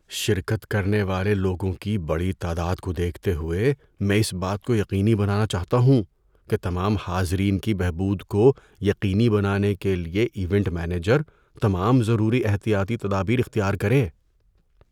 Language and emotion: Urdu, fearful